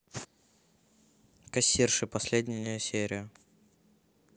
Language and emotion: Russian, neutral